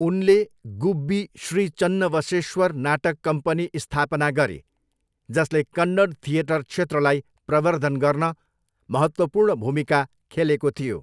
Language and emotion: Nepali, neutral